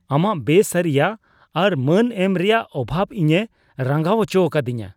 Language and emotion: Santali, disgusted